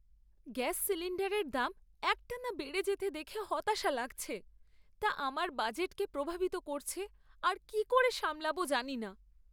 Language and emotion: Bengali, sad